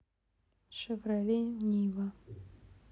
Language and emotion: Russian, neutral